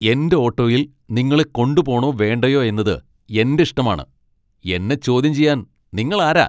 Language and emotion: Malayalam, angry